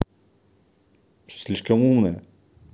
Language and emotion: Russian, angry